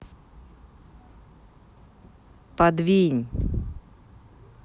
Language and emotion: Russian, angry